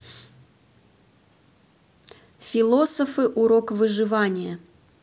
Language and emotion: Russian, neutral